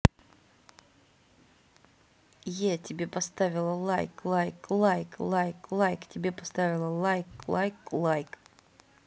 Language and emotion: Russian, positive